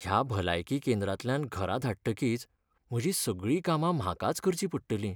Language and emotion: Goan Konkani, sad